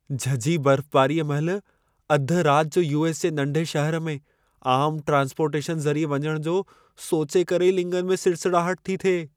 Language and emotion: Sindhi, fearful